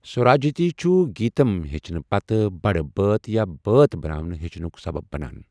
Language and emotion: Kashmiri, neutral